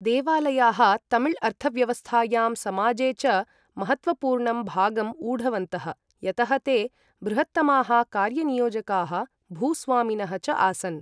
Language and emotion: Sanskrit, neutral